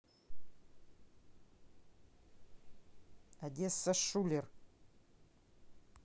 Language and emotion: Russian, neutral